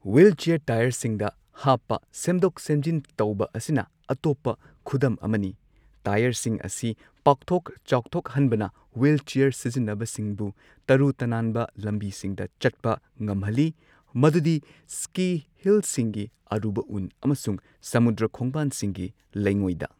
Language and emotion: Manipuri, neutral